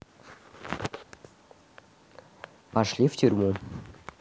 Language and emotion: Russian, neutral